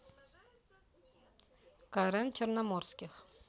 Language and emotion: Russian, neutral